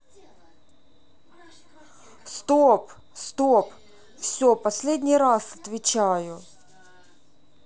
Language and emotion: Russian, angry